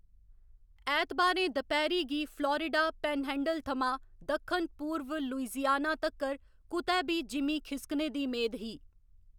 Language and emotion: Dogri, neutral